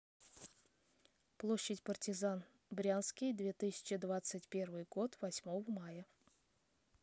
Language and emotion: Russian, neutral